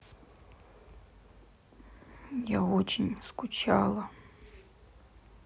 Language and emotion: Russian, sad